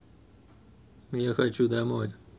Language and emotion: Russian, sad